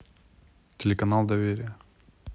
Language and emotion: Russian, neutral